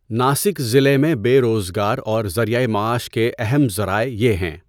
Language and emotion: Urdu, neutral